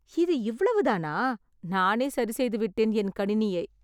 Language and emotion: Tamil, surprised